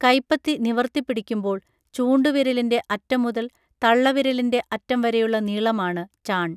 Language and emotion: Malayalam, neutral